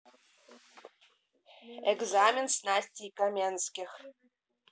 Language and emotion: Russian, neutral